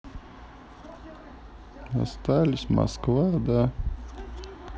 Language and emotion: Russian, sad